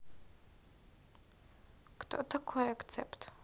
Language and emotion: Russian, neutral